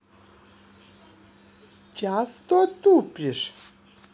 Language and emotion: Russian, neutral